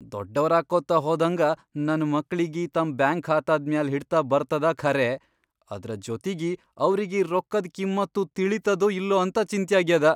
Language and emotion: Kannada, fearful